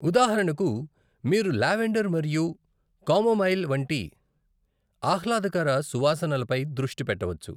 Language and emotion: Telugu, neutral